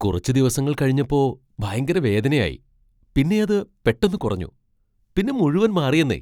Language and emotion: Malayalam, surprised